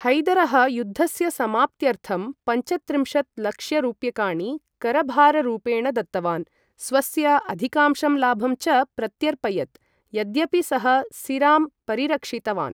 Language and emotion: Sanskrit, neutral